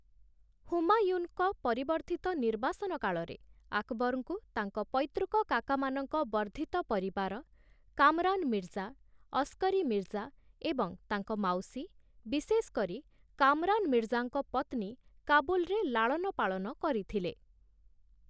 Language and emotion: Odia, neutral